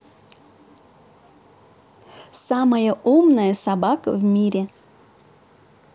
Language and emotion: Russian, positive